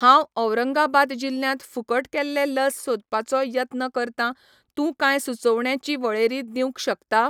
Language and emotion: Goan Konkani, neutral